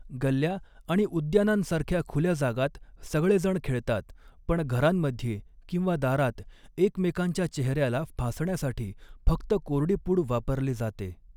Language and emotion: Marathi, neutral